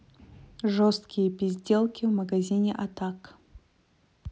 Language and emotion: Russian, neutral